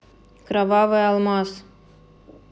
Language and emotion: Russian, neutral